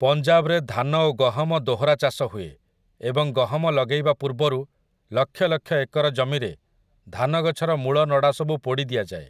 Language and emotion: Odia, neutral